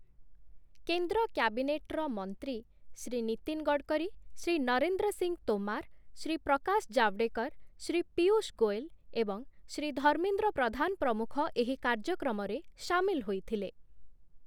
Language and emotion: Odia, neutral